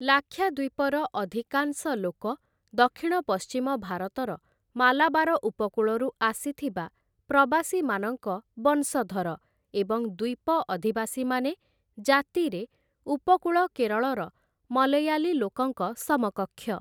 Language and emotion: Odia, neutral